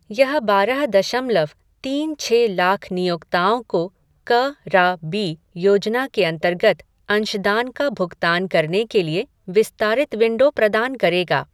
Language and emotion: Hindi, neutral